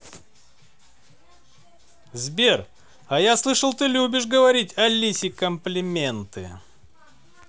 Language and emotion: Russian, positive